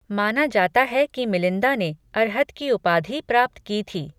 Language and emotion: Hindi, neutral